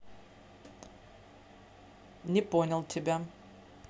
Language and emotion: Russian, neutral